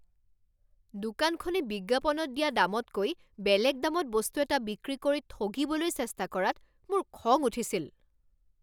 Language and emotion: Assamese, angry